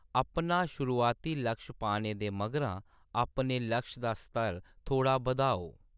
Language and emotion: Dogri, neutral